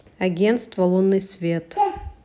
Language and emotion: Russian, neutral